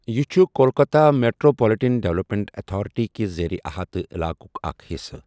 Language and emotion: Kashmiri, neutral